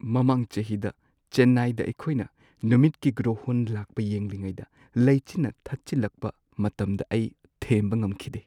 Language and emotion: Manipuri, sad